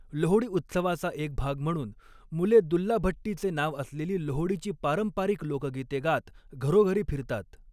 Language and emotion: Marathi, neutral